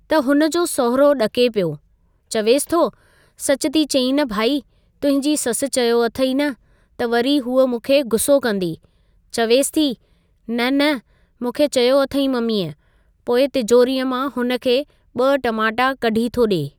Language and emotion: Sindhi, neutral